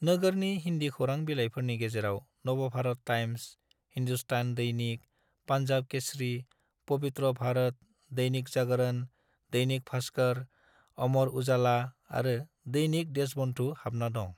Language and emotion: Bodo, neutral